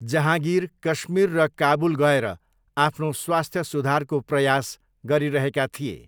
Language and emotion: Nepali, neutral